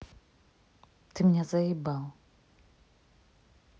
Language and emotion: Russian, angry